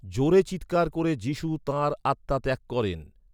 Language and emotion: Bengali, neutral